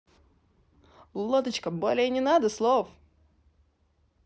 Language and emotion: Russian, positive